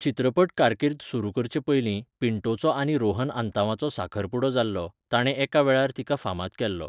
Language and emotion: Goan Konkani, neutral